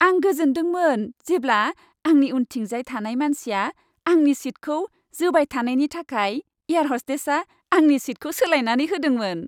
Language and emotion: Bodo, happy